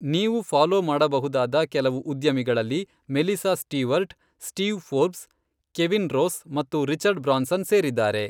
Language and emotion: Kannada, neutral